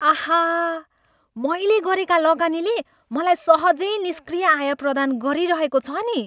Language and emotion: Nepali, happy